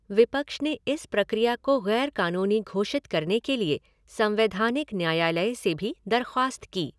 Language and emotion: Hindi, neutral